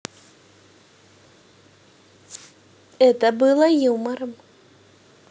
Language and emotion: Russian, positive